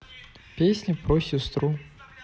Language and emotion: Russian, neutral